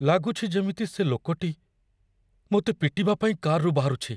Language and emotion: Odia, fearful